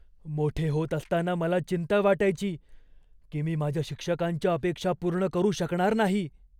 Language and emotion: Marathi, fearful